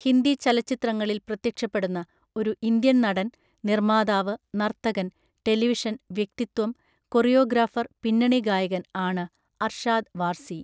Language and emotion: Malayalam, neutral